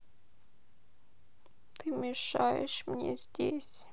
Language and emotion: Russian, sad